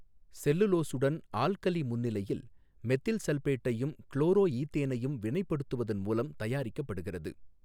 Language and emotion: Tamil, neutral